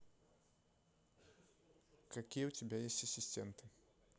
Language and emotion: Russian, neutral